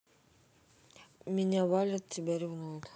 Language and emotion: Russian, neutral